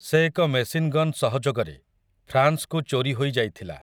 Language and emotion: Odia, neutral